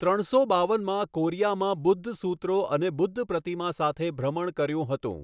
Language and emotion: Gujarati, neutral